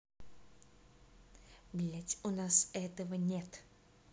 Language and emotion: Russian, angry